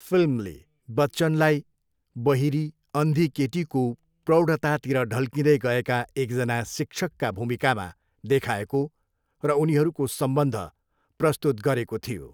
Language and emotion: Nepali, neutral